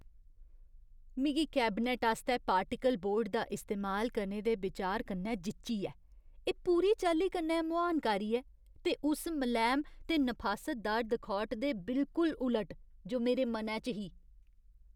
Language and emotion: Dogri, disgusted